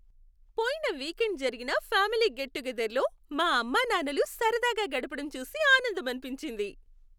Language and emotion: Telugu, happy